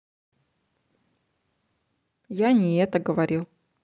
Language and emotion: Russian, neutral